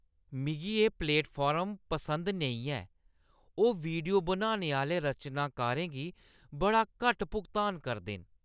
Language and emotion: Dogri, disgusted